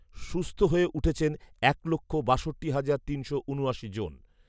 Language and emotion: Bengali, neutral